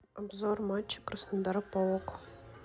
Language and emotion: Russian, neutral